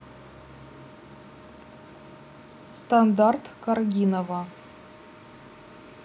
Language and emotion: Russian, neutral